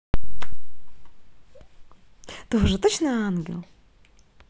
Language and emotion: Russian, positive